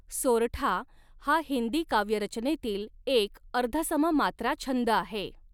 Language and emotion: Marathi, neutral